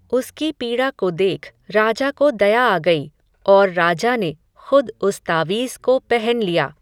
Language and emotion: Hindi, neutral